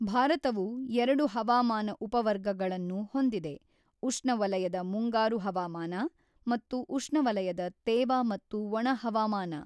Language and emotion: Kannada, neutral